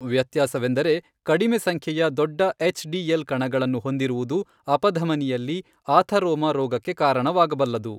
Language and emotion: Kannada, neutral